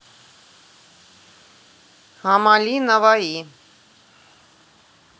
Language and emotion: Russian, neutral